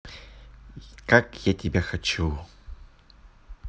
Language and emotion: Russian, neutral